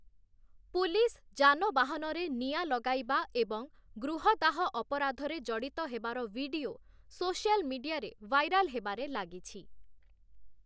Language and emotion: Odia, neutral